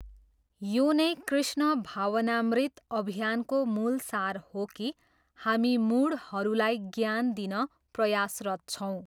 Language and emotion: Nepali, neutral